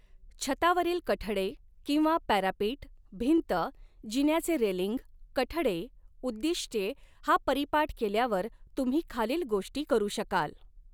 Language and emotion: Marathi, neutral